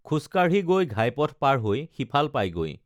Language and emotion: Assamese, neutral